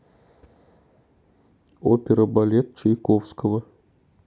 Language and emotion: Russian, neutral